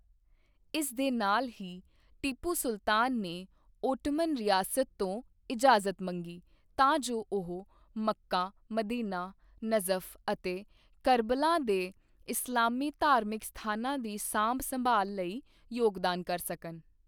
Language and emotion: Punjabi, neutral